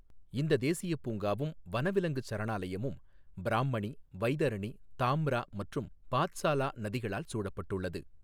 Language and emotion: Tamil, neutral